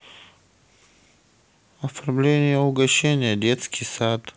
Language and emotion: Russian, neutral